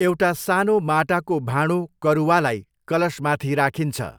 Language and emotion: Nepali, neutral